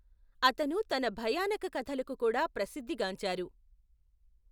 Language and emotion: Telugu, neutral